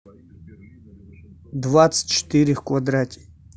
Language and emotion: Russian, neutral